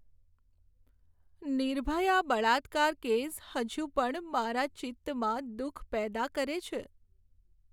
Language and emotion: Gujarati, sad